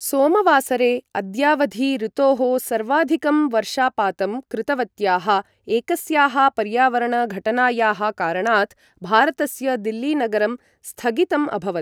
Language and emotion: Sanskrit, neutral